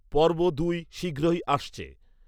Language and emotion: Bengali, neutral